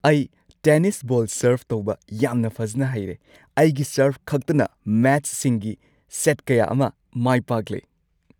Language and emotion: Manipuri, happy